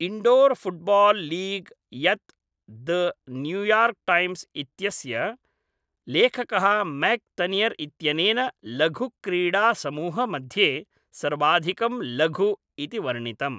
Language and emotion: Sanskrit, neutral